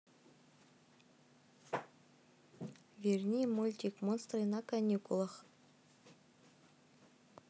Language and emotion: Russian, neutral